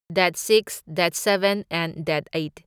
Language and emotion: Manipuri, neutral